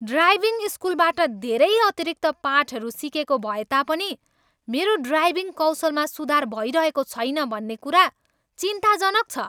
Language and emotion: Nepali, angry